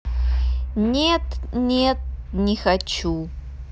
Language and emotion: Russian, neutral